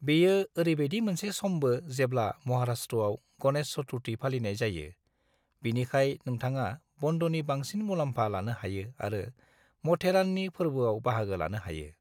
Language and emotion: Bodo, neutral